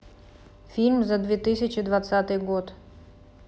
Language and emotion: Russian, neutral